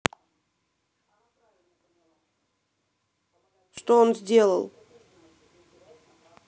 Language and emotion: Russian, angry